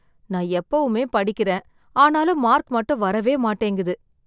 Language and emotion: Tamil, sad